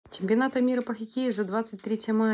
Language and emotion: Russian, neutral